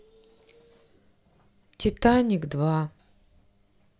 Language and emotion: Russian, sad